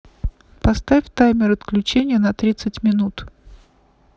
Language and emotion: Russian, neutral